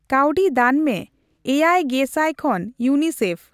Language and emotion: Santali, neutral